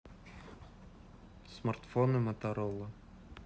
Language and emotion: Russian, neutral